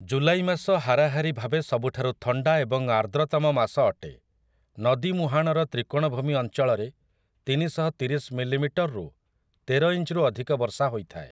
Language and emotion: Odia, neutral